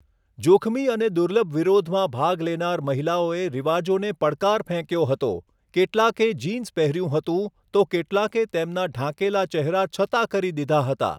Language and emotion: Gujarati, neutral